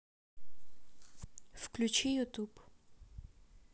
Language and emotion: Russian, neutral